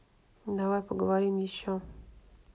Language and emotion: Russian, neutral